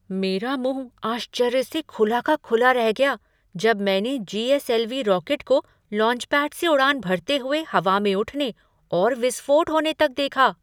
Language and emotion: Hindi, surprised